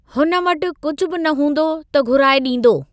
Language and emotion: Sindhi, neutral